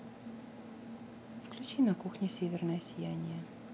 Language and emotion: Russian, neutral